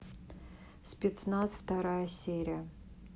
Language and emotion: Russian, neutral